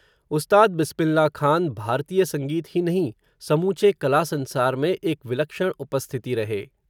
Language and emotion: Hindi, neutral